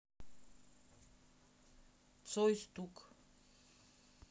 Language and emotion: Russian, neutral